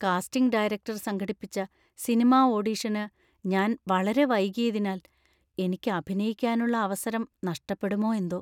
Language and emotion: Malayalam, fearful